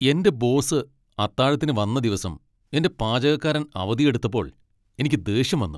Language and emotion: Malayalam, angry